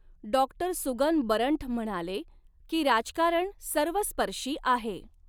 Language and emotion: Marathi, neutral